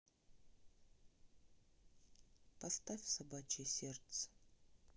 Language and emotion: Russian, sad